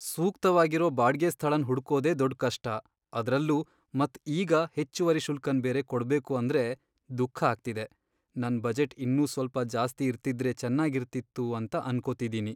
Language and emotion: Kannada, sad